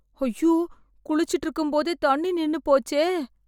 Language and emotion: Tamil, fearful